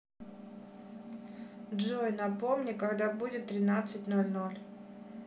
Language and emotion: Russian, neutral